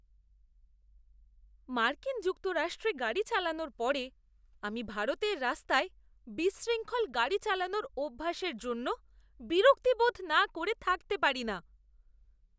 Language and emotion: Bengali, disgusted